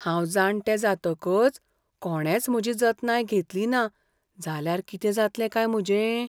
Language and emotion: Goan Konkani, fearful